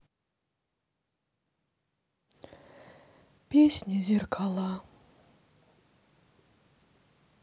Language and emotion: Russian, sad